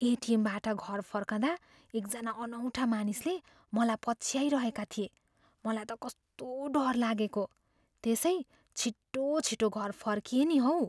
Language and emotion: Nepali, fearful